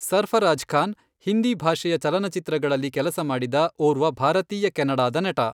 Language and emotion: Kannada, neutral